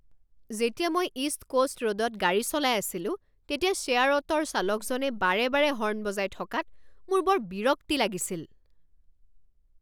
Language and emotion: Assamese, angry